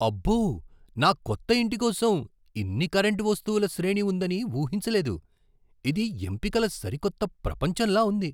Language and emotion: Telugu, surprised